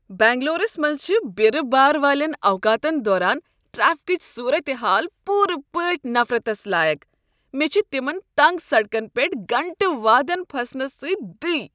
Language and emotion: Kashmiri, disgusted